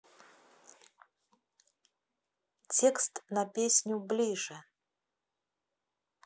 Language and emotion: Russian, neutral